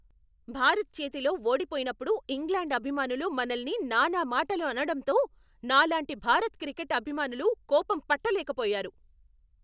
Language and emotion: Telugu, angry